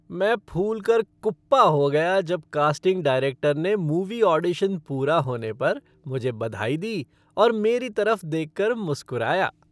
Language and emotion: Hindi, happy